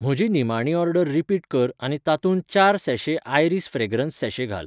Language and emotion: Goan Konkani, neutral